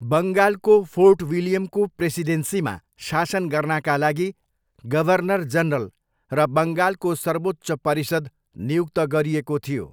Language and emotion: Nepali, neutral